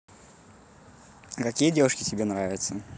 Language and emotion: Russian, positive